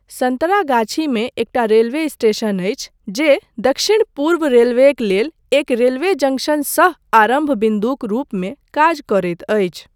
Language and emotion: Maithili, neutral